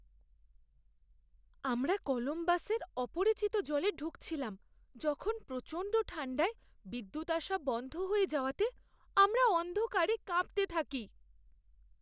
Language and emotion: Bengali, fearful